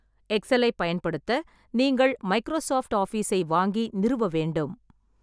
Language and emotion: Tamil, neutral